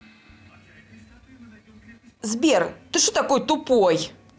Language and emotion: Russian, angry